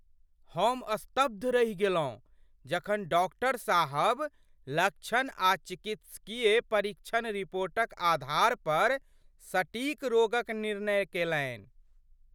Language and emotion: Maithili, surprised